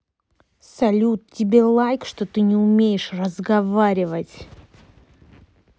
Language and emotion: Russian, angry